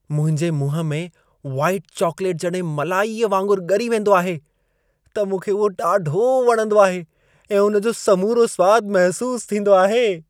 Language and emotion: Sindhi, happy